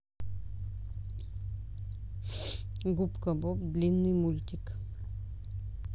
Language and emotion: Russian, neutral